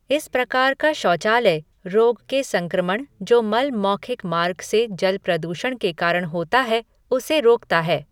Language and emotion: Hindi, neutral